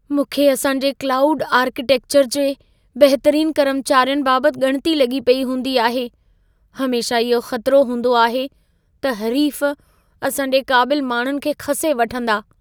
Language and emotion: Sindhi, fearful